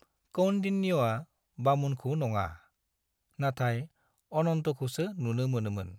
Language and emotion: Bodo, neutral